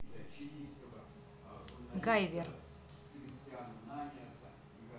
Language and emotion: Russian, neutral